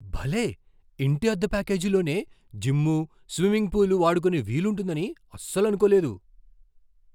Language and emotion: Telugu, surprised